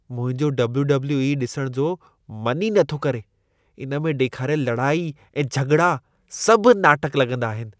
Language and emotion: Sindhi, disgusted